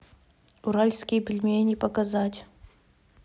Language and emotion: Russian, neutral